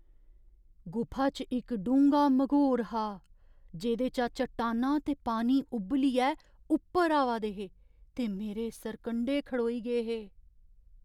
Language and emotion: Dogri, fearful